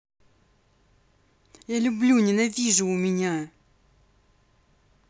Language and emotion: Russian, angry